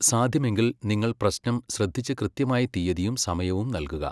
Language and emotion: Malayalam, neutral